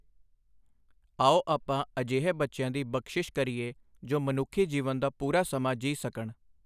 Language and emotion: Punjabi, neutral